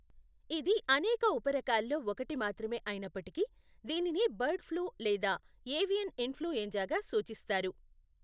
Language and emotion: Telugu, neutral